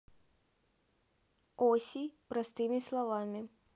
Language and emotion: Russian, neutral